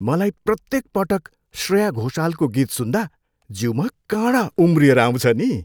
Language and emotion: Nepali, happy